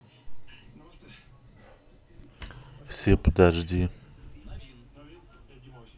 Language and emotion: Russian, neutral